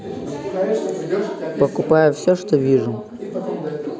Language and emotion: Russian, neutral